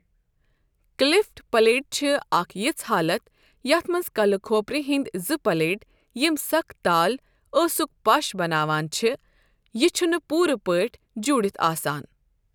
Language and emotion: Kashmiri, neutral